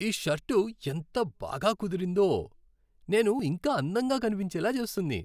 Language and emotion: Telugu, happy